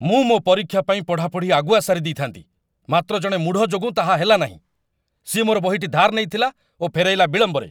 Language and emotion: Odia, angry